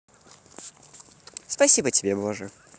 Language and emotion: Russian, positive